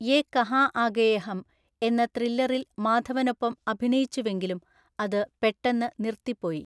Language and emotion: Malayalam, neutral